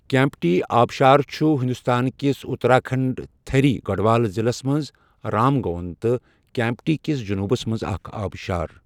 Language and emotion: Kashmiri, neutral